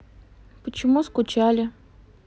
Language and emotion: Russian, neutral